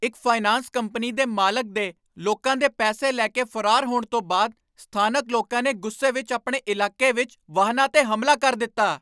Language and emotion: Punjabi, angry